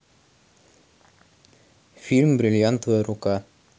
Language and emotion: Russian, neutral